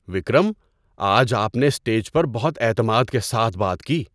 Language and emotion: Urdu, surprised